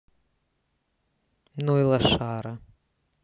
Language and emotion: Russian, angry